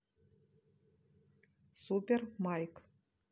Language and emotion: Russian, neutral